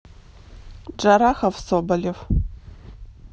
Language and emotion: Russian, neutral